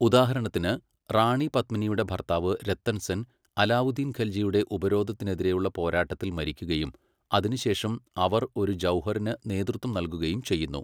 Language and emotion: Malayalam, neutral